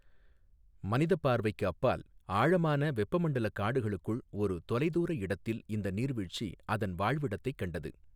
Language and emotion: Tamil, neutral